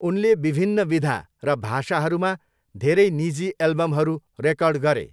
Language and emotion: Nepali, neutral